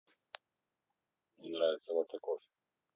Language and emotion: Russian, neutral